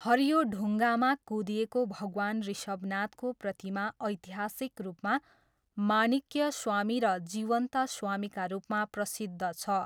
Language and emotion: Nepali, neutral